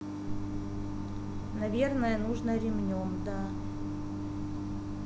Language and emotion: Russian, neutral